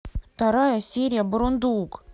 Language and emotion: Russian, angry